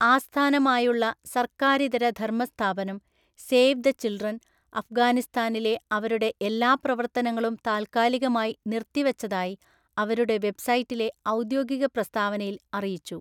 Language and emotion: Malayalam, neutral